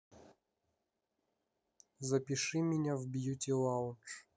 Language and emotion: Russian, neutral